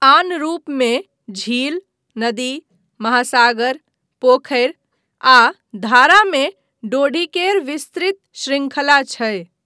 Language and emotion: Maithili, neutral